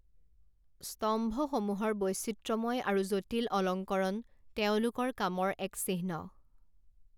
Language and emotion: Assamese, neutral